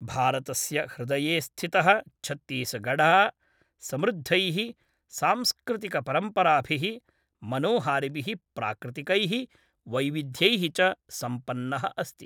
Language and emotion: Sanskrit, neutral